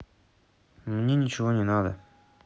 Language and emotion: Russian, neutral